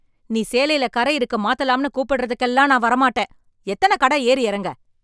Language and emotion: Tamil, angry